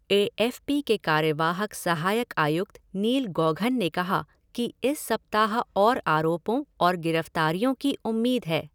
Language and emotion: Hindi, neutral